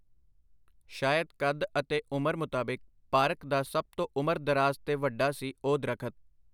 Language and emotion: Punjabi, neutral